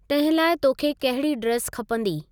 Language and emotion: Sindhi, neutral